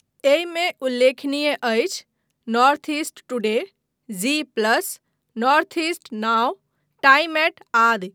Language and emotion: Maithili, neutral